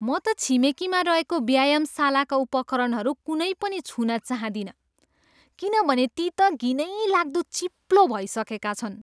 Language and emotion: Nepali, disgusted